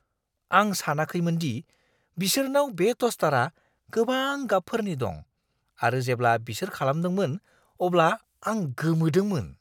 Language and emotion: Bodo, surprised